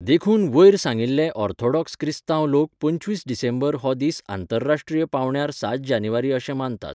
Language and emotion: Goan Konkani, neutral